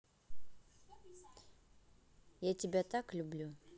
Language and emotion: Russian, neutral